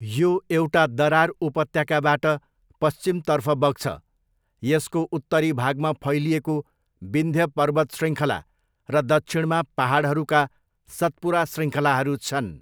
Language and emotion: Nepali, neutral